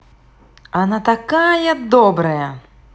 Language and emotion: Russian, positive